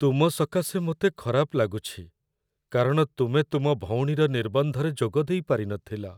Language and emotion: Odia, sad